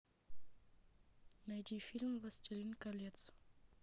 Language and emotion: Russian, neutral